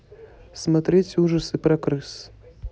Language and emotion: Russian, neutral